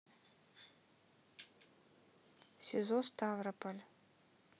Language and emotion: Russian, neutral